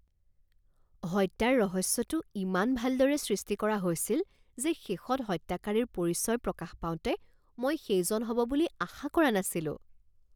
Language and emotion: Assamese, surprised